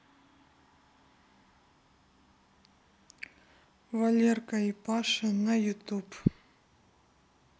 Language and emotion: Russian, neutral